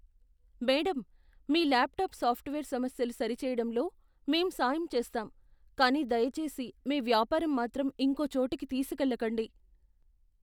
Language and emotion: Telugu, fearful